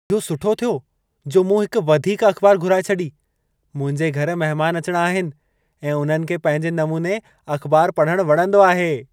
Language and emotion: Sindhi, happy